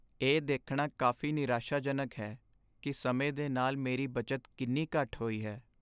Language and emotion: Punjabi, sad